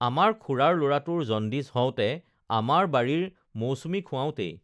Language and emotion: Assamese, neutral